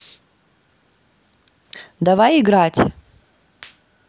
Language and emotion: Russian, positive